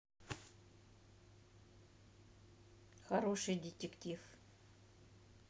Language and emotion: Russian, neutral